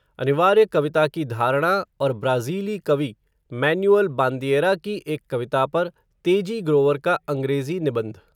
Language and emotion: Hindi, neutral